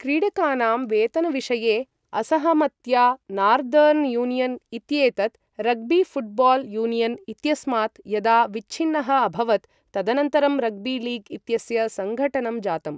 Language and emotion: Sanskrit, neutral